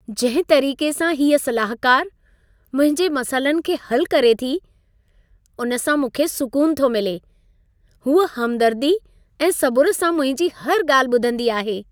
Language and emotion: Sindhi, happy